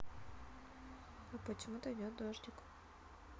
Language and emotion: Russian, neutral